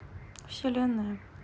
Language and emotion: Russian, sad